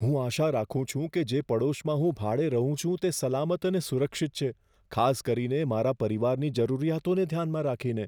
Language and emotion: Gujarati, fearful